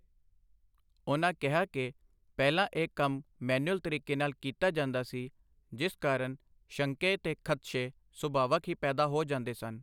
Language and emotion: Punjabi, neutral